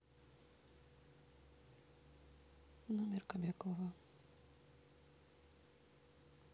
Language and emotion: Russian, neutral